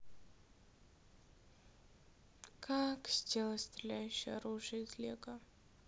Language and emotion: Russian, sad